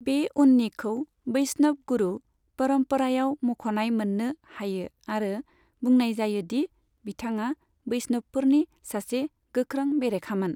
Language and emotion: Bodo, neutral